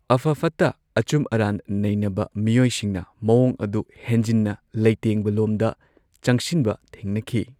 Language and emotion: Manipuri, neutral